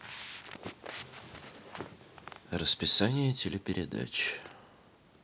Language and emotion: Russian, neutral